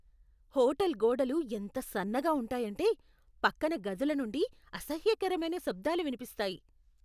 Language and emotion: Telugu, disgusted